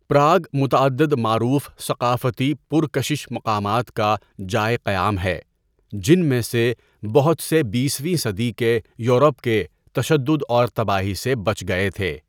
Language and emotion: Urdu, neutral